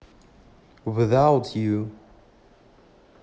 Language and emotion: Russian, neutral